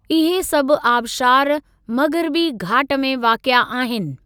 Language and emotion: Sindhi, neutral